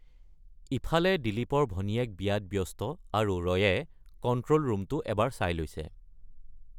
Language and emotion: Assamese, neutral